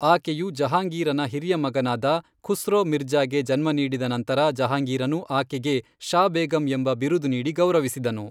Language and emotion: Kannada, neutral